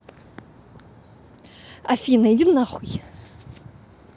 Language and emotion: Russian, angry